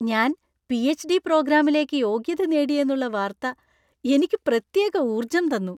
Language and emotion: Malayalam, happy